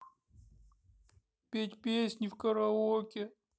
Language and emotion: Russian, sad